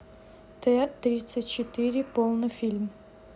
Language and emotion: Russian, neutral